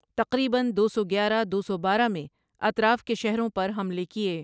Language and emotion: Urdu, neutral